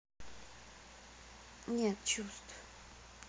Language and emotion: Russian, sad